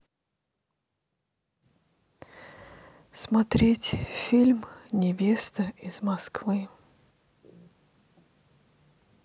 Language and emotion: Russian, sad